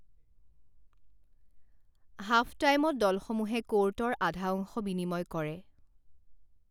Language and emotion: Assamese, neutral